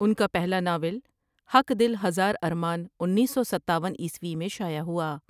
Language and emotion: Urdu, neutral